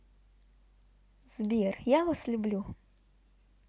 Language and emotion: Russian, positive